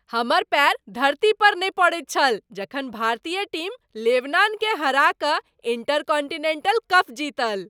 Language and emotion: Maithili, happy